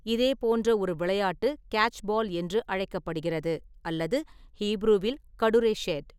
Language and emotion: Tamil, neutral